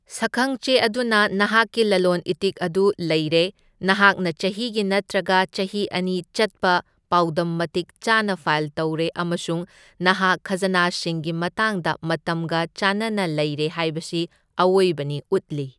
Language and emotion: Manipuri, neutral